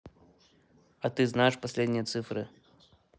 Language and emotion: Russian, neutral